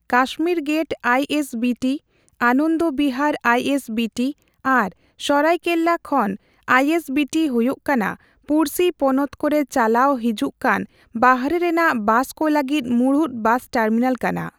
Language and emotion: Santali, neutral